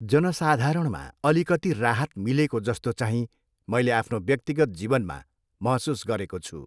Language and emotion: Nepali, neutral